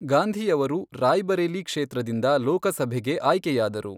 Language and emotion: Kannada, neutral